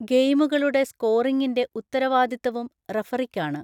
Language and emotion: Malayalam, neutral